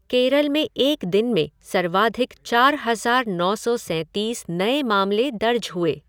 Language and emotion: Hindi, neutral